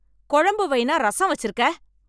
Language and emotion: Tamil, angry